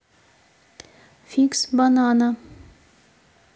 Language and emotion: Russian, neutral